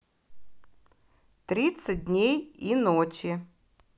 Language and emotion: Russian, neutral